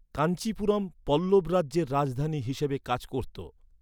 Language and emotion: Bengali, neutral